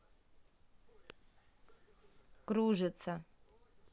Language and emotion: Russian, neutral